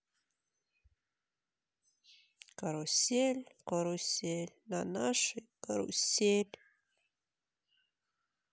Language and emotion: Russian, sad